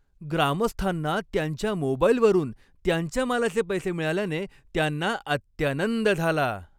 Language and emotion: Marathi, happy